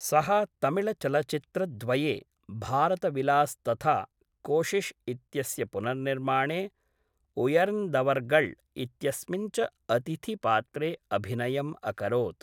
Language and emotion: Sanskrit, neutral